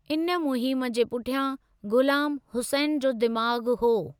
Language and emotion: Sindhi, neutral